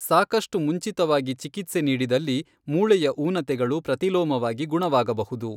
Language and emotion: Kannada, neutral